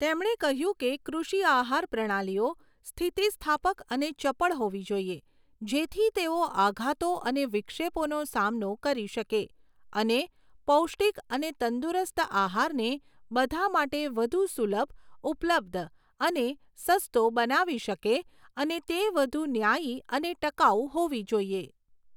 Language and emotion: Gujarati, neutral